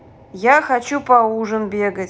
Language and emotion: Russian, neutral